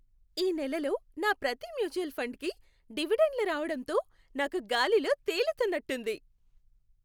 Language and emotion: Telugu, happy